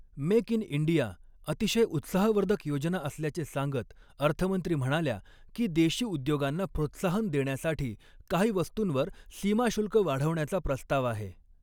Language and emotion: Marathi, neutral